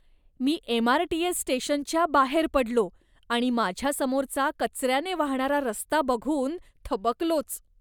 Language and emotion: Marathi, disgusted